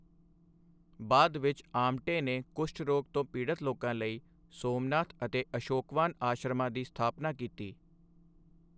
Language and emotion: Punjabi, neutral